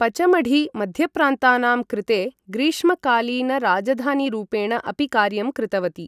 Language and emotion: Sanskrit, neutral